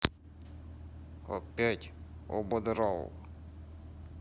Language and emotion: Russian, neutral